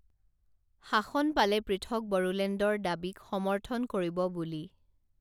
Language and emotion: Assamese, neutral